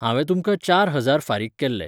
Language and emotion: Goan Konkani, neutral